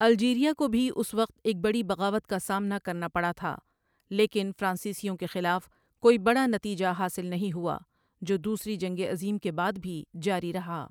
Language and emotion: Urdu, neutral